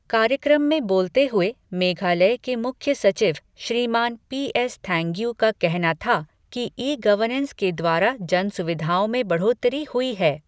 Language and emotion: Hindi, neutral